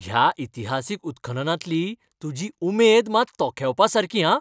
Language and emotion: Goan Konkani, happy